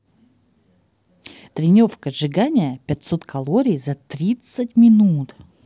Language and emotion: Russian, positive